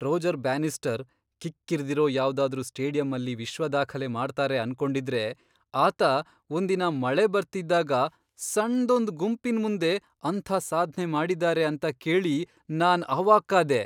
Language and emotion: Kannada, surprised